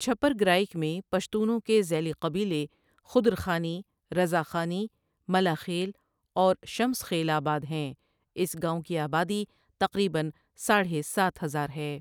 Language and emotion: Urdu, neutral